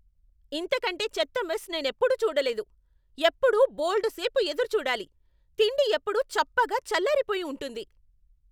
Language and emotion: Telugu, angry